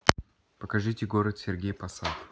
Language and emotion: Russian, neutral